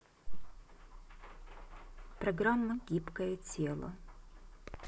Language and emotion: Russian, neutral